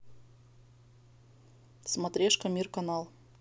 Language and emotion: Russian, neutral